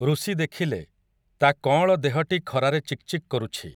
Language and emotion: Odia, neutral